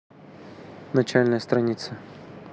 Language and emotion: Russian, neutral